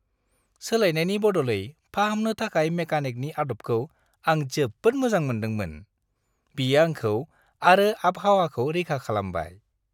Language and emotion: Bodo, happy